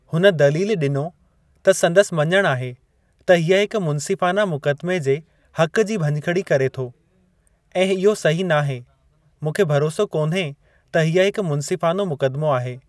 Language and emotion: Sindhi, neutral